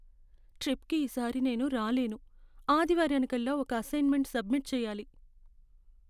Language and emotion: Telugu, sad